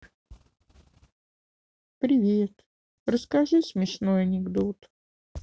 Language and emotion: Russian, sad